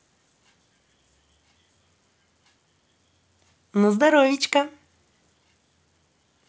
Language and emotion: Russian, positive